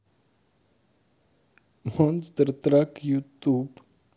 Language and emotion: Russian, positive